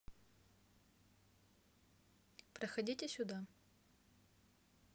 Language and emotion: Russian, neutral